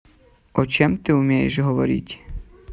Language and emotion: Russian, neutral